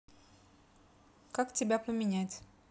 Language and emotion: Russian, neutral